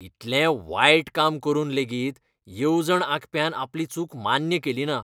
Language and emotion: Goan Konkani, disgusted